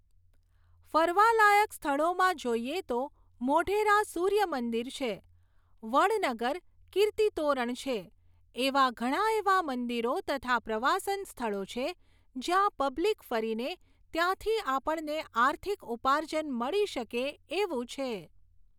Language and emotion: Gujarati, neutral